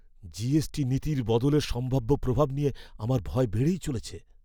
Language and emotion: Bengali, fearful